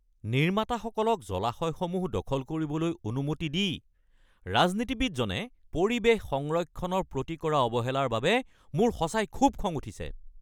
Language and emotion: Assamese, angry